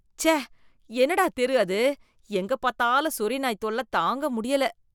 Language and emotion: Tamil, disgusted